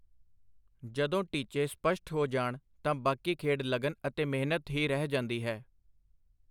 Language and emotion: Punjabi, neutral